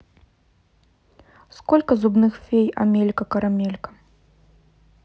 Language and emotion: Russian, neutral